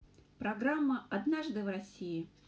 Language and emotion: Russian, neutral